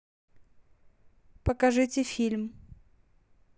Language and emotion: Russian, neutral